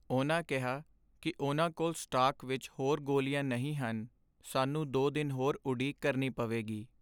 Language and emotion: Punjabi, sad